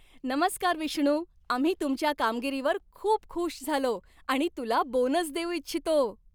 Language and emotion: Marathi, happy